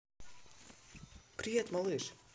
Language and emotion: Russian, positive